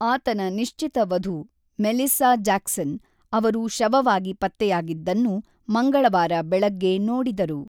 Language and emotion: Kannada, neutral